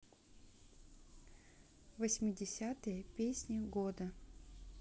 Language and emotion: Russian, neutral